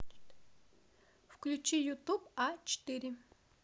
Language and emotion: Russian, neutral